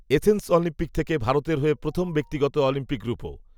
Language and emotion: Bengali, neutral